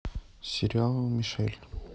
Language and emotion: Russian, neutral